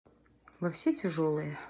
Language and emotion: Russian, neutral